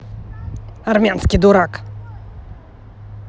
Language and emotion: Russian, angry